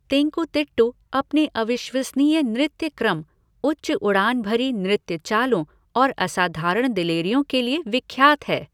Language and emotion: Hindi, neutral